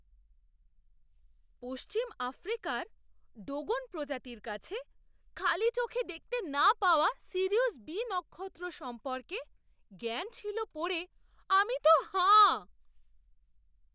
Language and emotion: Bengali, surprised